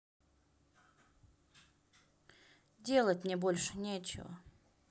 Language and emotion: Russian, neutral